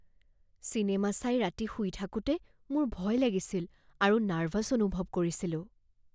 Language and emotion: Assamese, fearful